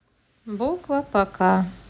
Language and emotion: Russian, neutral